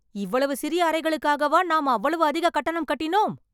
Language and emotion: Tamil, angry